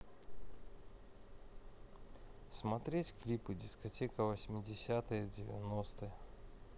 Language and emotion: Russian, neutral